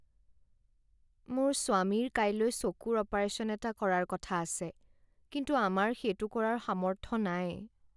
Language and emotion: Assamese, sad